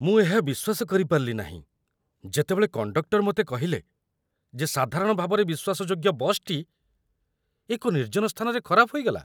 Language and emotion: Odia, surprised